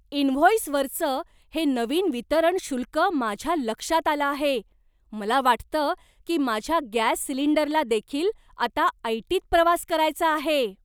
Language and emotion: Marathi, surprised